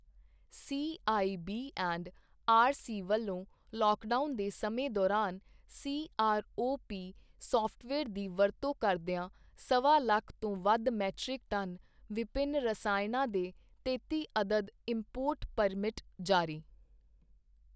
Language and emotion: Punjabi, neutral